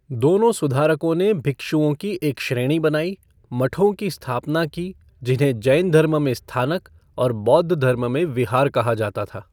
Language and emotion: Hindi, neutral